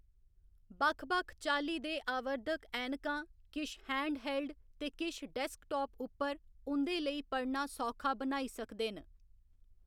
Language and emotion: Dogri, neutral